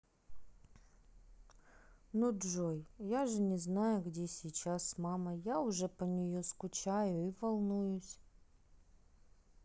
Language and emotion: Russian, sad